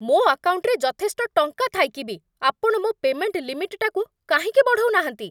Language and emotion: Odia, angry